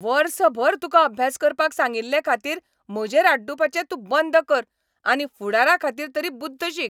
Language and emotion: Goan Konkani, angry